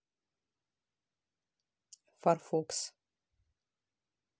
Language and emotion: Russian, neutral